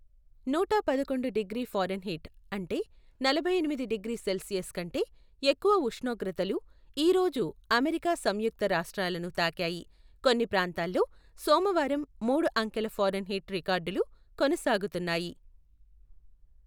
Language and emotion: Telugu, neutral